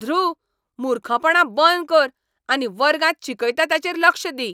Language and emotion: Goan Konkani, angry